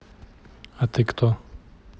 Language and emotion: Russian, neutral